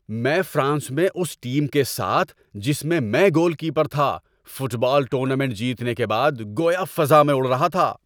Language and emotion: Urdu, happy